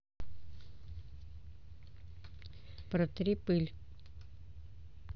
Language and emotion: Russian, neutral